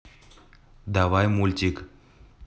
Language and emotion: Russian, neutral